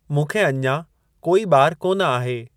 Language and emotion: Sindhi, neutral